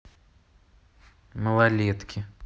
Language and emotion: Russian, neutral